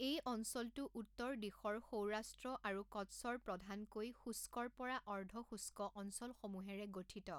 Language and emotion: Assamese, neutral